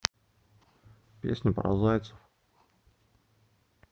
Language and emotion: Russian, neutral